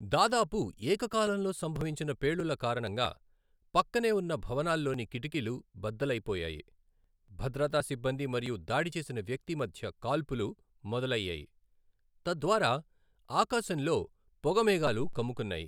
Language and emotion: Telugu, neutral